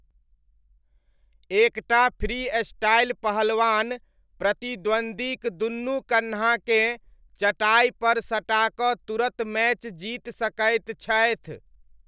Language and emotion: Maithili, neutral